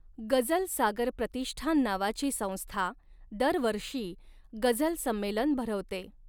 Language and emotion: Marathi, neutral